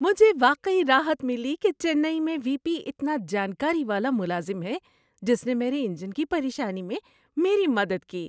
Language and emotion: Urdu, happy